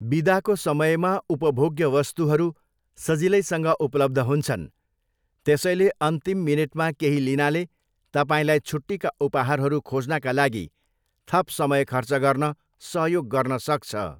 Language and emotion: Nepali, neutral